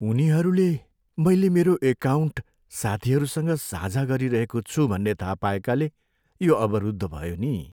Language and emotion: Nepali, sad